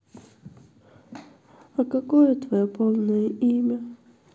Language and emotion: Russian, sad